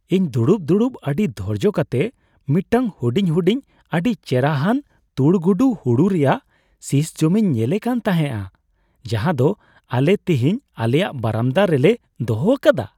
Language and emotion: Santali, happy